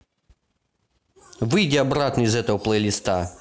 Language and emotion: Russian, angry